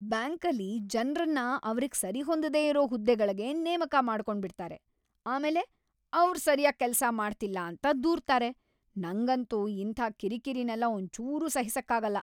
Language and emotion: Kannada, angry